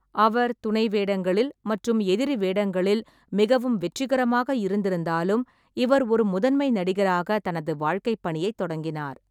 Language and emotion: Tamil, neutral